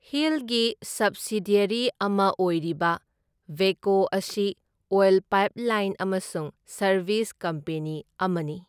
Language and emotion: Manipuri, neutral